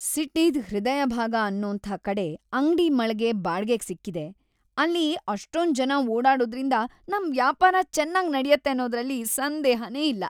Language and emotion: Kannada, happy